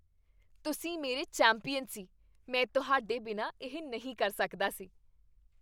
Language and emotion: Punjabi, happy